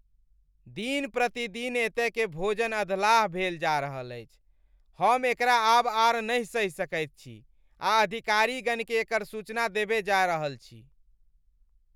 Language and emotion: Maithili, angry